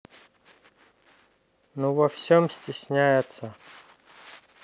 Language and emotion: Russian, neutral